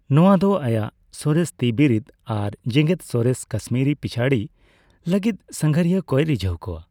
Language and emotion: Santali, neutral